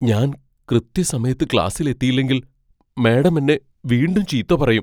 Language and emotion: Malayalam, fearful